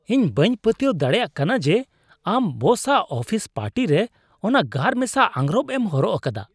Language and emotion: Santali, disgusted